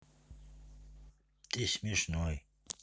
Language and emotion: Russian, neutral